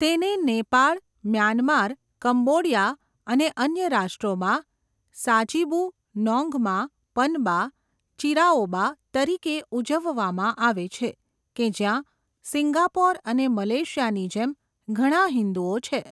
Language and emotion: Gujarati, neutral